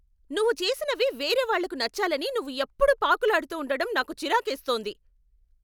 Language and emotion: Telugu, angry